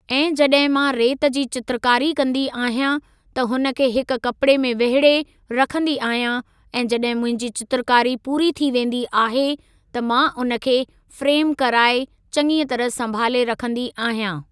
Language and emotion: Sindhi, neutral